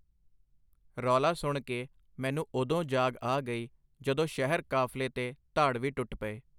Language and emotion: Punjabi, neutral